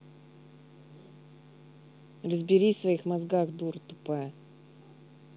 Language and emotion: Russian, angry